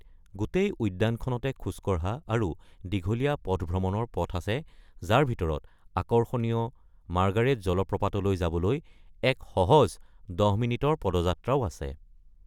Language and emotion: Assamese, neutral